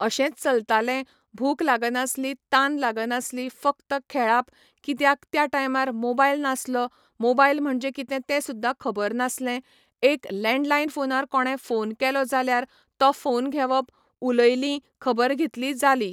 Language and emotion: Goan Konkani, neutral